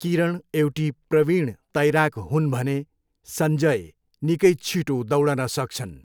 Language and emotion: Nepali, neutral